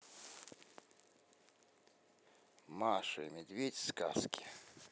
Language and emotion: Russian, neutral